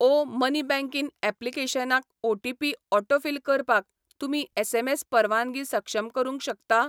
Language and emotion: Goan Konkani, neutral